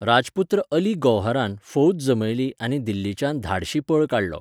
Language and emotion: Goan Konkani, neutral